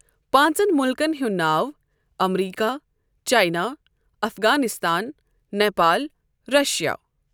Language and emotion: Kashmiri, neutral